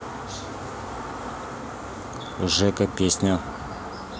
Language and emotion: Russian, neutral